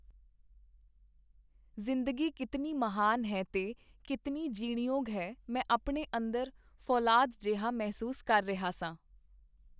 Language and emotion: Punjabi, neutral